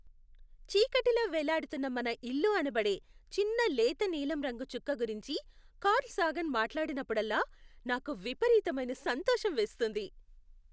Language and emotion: Telugu, happy